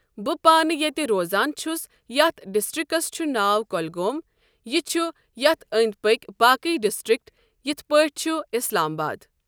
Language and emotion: Kashmiri, neutral